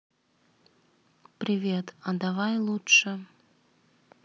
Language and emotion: Russian, neutral